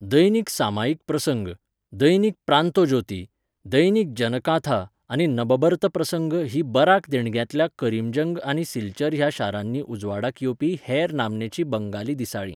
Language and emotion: Goan Konkani, neutral